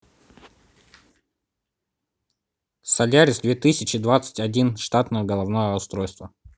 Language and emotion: Russian, neutral